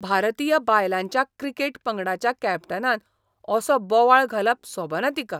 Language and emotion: Goan Konkani, disgusted